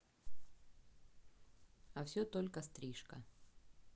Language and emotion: Russian, neutral